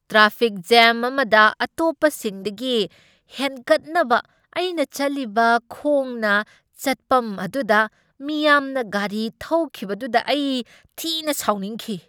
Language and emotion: Manipuri, angry